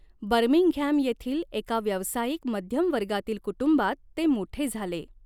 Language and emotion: Marathi, neutral